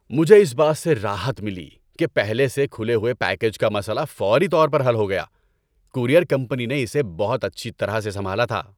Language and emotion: Urdu, happy